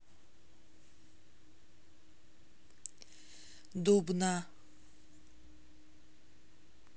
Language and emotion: Russian, neutral